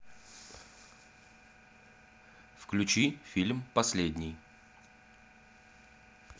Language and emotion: Russian, neutral